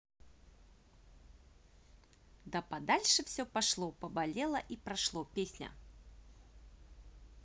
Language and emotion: Russian, positive